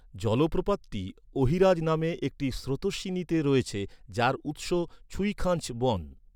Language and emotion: Bengali, neutral